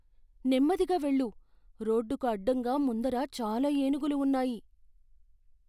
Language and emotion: Telugu, fearful